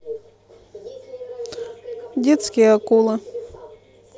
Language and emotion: Russian, neutral